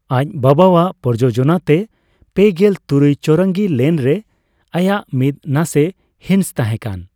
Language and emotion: Santali, neutral